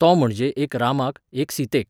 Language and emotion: Goan Konkani, neutral